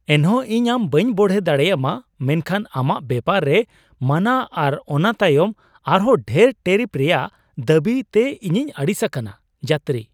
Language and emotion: Santali, surprised